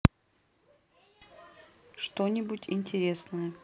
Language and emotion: Russian, neutral